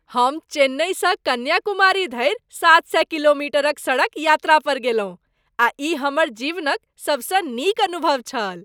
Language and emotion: Maithili, happy